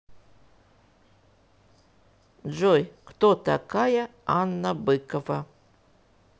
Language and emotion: Russian, neutral